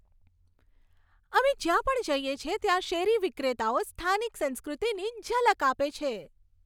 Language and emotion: Gujarati, happy